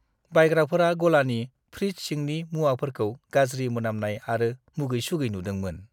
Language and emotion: Bodo, disgusted